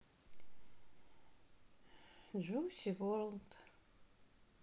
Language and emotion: Russian, sad